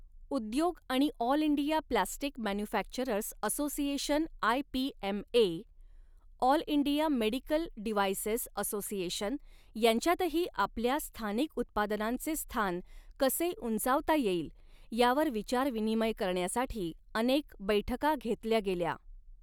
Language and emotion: Marathi, neutral